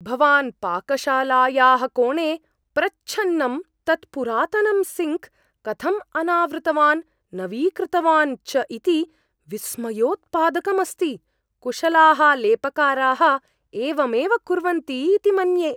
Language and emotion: Sanskrit, surprised